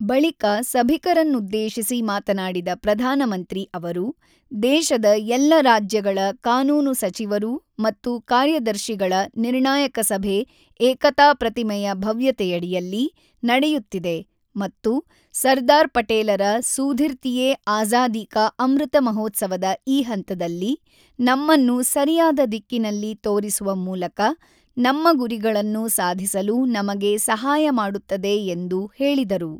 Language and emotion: Kannada, neutral